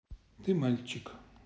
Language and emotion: Russian, neutral